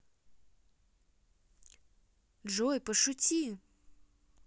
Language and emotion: Russian, neutral